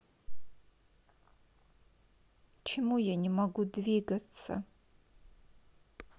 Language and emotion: Russian, sad